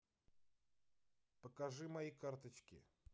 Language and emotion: Russian, neutral